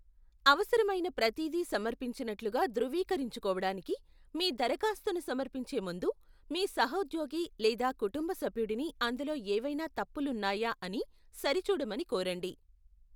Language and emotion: Telugu, neutral